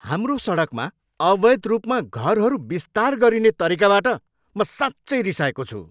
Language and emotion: Nepali, angry